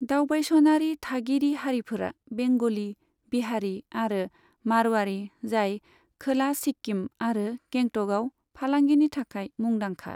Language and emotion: Bodo, neutral